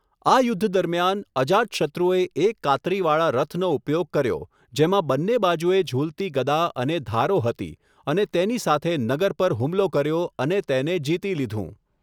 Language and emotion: Gujarati, neutral